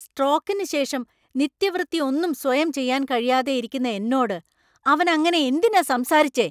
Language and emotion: Malayalam, angry